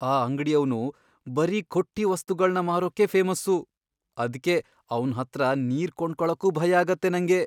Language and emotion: Kannada, fearful